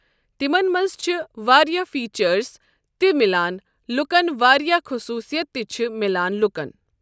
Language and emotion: Kashmiri, neutral